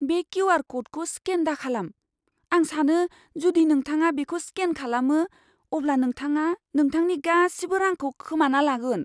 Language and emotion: Bodo, fearful